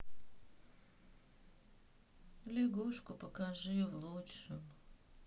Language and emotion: Russian, sad